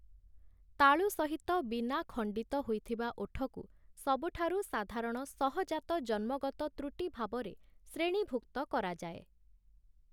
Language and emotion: Odia, neutral